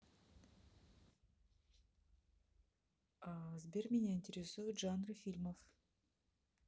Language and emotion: Russian, neutral